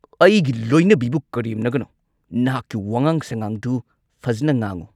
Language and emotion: Manipuri, angry